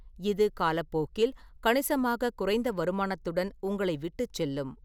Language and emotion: Tamil, neutral